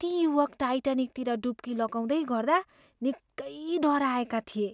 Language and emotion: Nepali, fearful